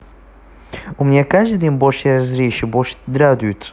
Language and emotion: Russian, neutral